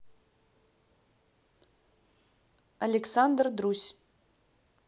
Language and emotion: Russian, neutral